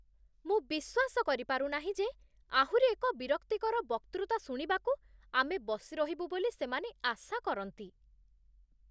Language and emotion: Odia, disgusted